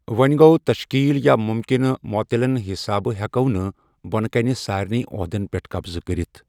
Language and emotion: Kashmiri, neutral